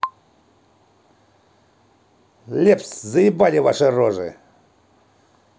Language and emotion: Russian, angry